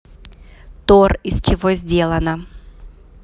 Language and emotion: Russian, neutral